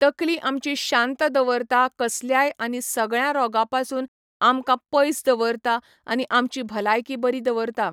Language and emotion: Goan Konkani, neutral